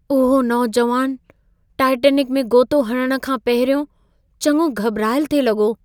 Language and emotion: Sindhi, fearful